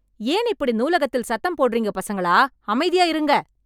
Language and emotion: Tamil, angry